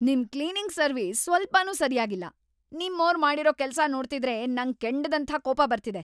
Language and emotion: Kannada, angry